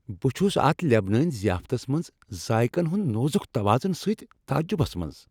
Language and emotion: Kashmiri, happy